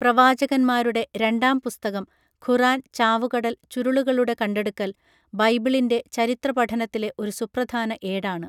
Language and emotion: Malayalam, neutral